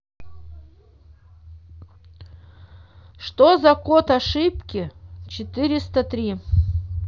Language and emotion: Russian, neutral